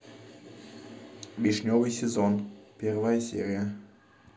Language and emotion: Russian, neutral